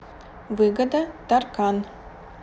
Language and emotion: Russian, neutral